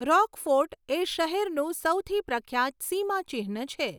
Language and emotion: Gujarati, neutral